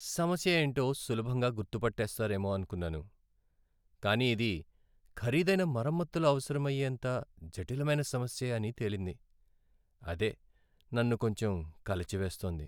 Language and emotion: Telugu, sad